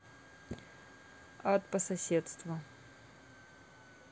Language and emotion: Russian, neutral